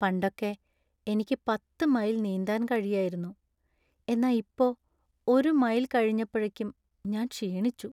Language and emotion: Malayalam, sad